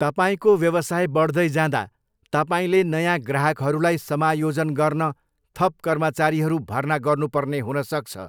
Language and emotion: Nepali, neutral